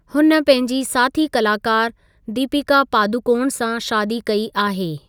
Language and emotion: Sindhi, neutral